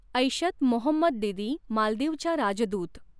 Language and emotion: Marathi, neutral